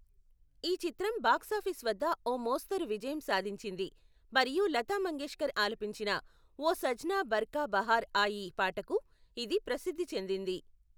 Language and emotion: Telugu, neutral